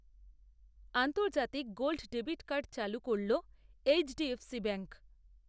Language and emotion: Bengali, neutral